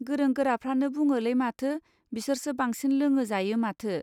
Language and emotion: Bodo, neutral